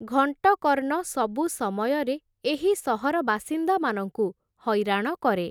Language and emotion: Odia, neutral